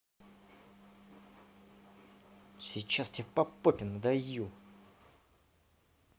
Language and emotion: Russian, angry